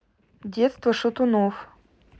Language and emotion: Russian, neutral